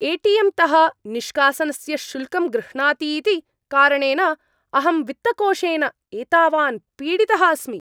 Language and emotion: Sanskrit, angry